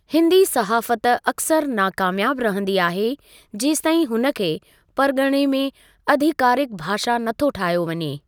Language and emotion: Sindhi, neutral